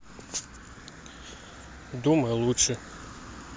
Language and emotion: Russian, neutral